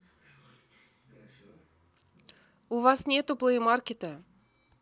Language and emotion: Russian, neutral